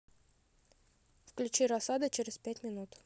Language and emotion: Russian, neutral